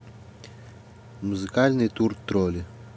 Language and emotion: Russian, neutral